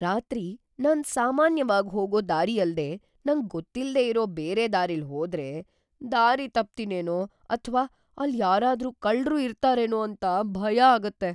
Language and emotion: Kannada, fearful